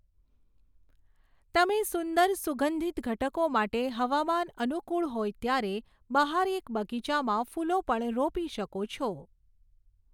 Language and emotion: Gujarati, neutral